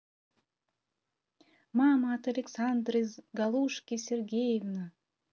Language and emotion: Russian, positive